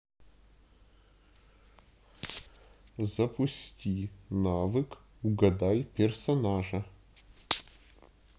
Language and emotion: Russian, neutral